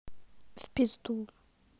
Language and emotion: Russian, sad